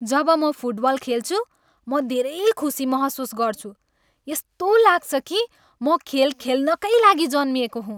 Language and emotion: Nepali, happy